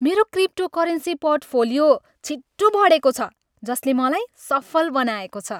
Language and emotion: Nepali, happy